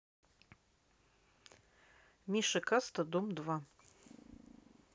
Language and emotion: Russian, neutral